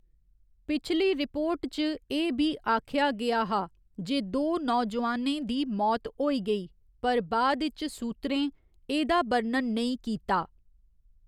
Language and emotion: Dogri, neutral